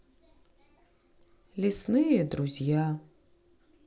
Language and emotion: Russian, sad